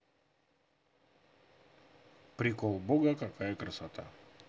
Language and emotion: Russian, neutral